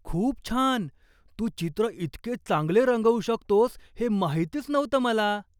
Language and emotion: Marathi, surprised